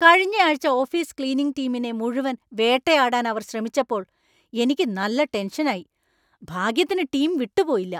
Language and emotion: Malayalam, angry